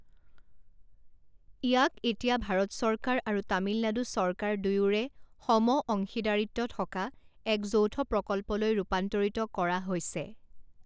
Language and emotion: Assamese, neutral